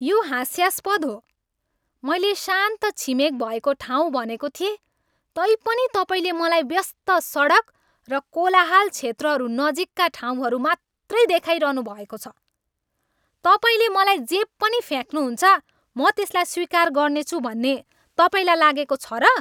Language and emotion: Nepali, angry